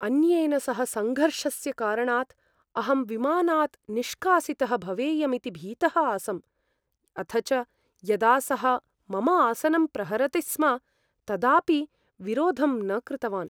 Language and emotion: Sanskrit, fearful